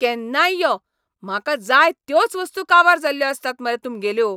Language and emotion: Goan Konkani, angry